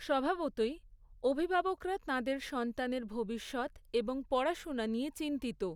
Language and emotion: Bengali, neutral